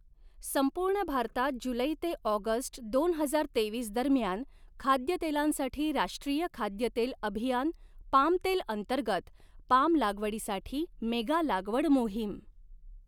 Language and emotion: Marathi, neutral